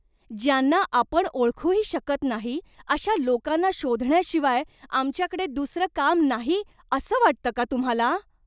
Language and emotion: Marathi, disgusted